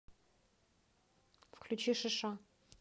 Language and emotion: Russian, neutral